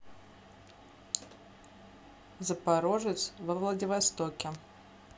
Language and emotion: Russian, neutral